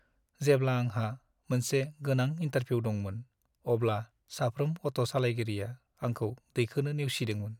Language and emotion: Bodo, sad